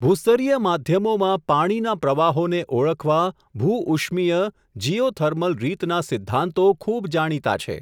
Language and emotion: Gujarati, neutral